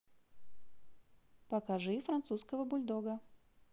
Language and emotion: Russian, positive